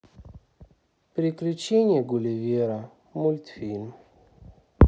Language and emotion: Russian, sad